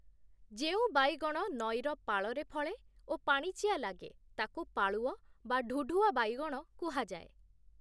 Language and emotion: Odia, neutral